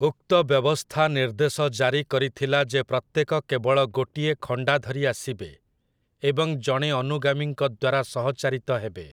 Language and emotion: Odia, neutral